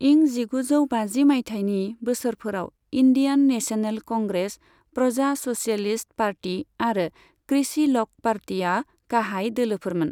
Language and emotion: Bodo, neutral